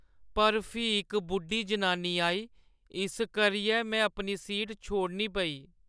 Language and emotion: Dogri, sad